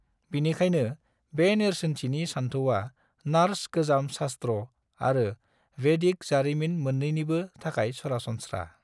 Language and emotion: Bodo, neutral